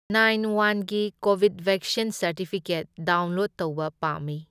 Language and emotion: Manipuri, neutral